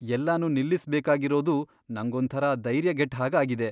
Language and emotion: Kannada, fearful